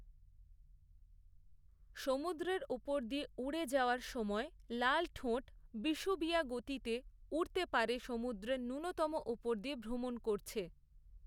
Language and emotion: Bengali, neutral